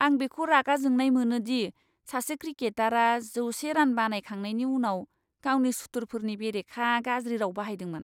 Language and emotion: Bodo, disgusted